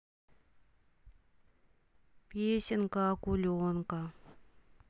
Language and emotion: Russian, sad